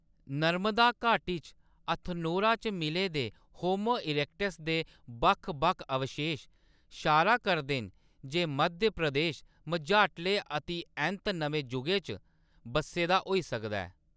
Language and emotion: Dogri, neutral